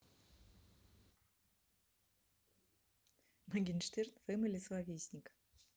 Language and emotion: Russian, neutral